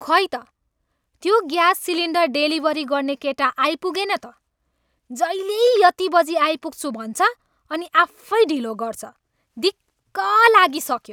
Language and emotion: Nepali, angry